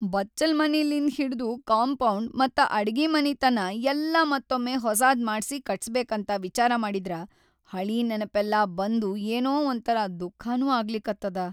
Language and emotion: Kannada, sad